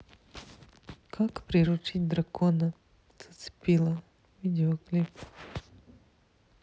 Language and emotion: Russian, neutral